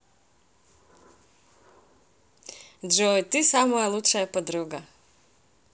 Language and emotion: Russian, positive